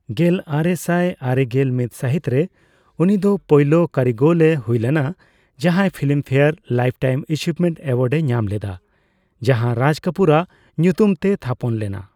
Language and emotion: Santali, neutral